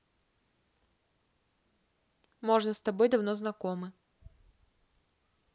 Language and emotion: Russian, neutral